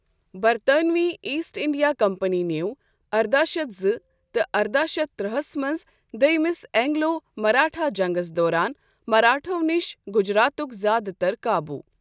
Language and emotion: Kashmiri, neutral